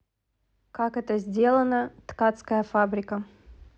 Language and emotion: Russian, neutral